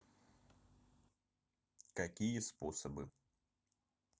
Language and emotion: Russian, neutral